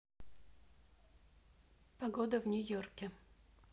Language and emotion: Russian, neutral